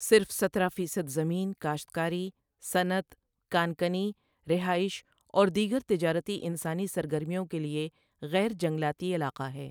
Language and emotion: Urdu, neutral